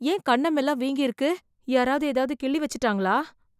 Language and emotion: Tamil, fearful